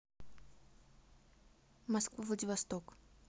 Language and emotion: Russian, neutral